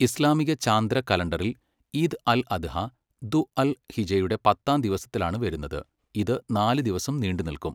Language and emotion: Malayalam, neutral